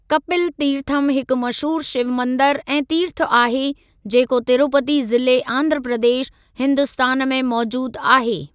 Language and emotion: Sindhi, neutral